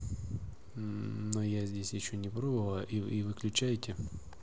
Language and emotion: Russian, neutral